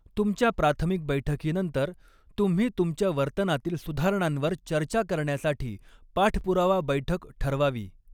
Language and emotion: Marathi, neutral